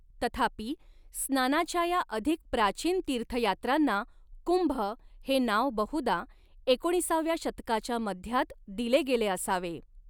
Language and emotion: Marathi, neutral